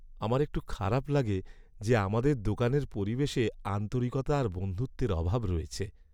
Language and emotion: Bengali, sad